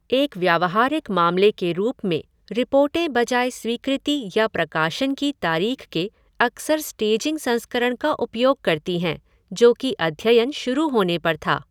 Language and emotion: Hindi, neutral